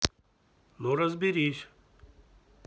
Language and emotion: Russian, neutral